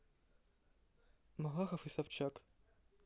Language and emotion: Russian, neutral